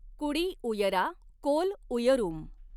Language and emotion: Marathi, neutral